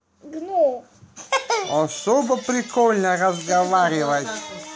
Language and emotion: Russian, positive